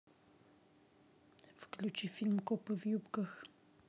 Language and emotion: Russian, neutral